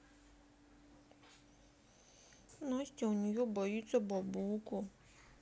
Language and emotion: Russian, sad